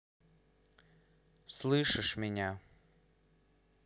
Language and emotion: Russian, angry